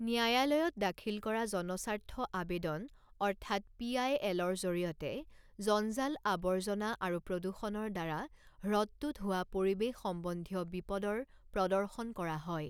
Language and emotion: Assamese, neutral